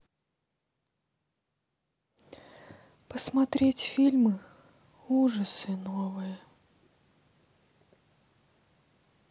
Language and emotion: Russian, sad